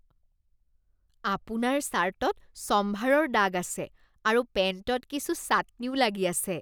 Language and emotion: Assamese, disgusted